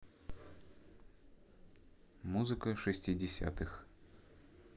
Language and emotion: Russian, neutral